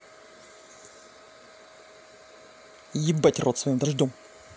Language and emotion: Russian, angry